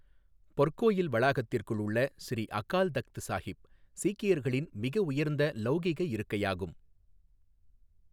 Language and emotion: Tamil, neutral